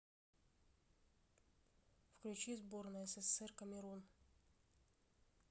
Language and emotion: Russian, neutral